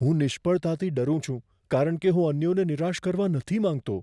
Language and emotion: Gujarati, fearful